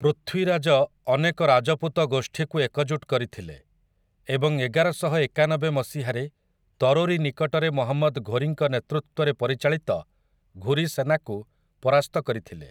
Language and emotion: Odia, neutral